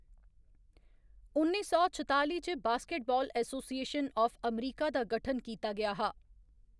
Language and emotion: Dogri, neutral